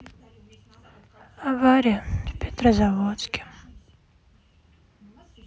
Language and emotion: Russian, sad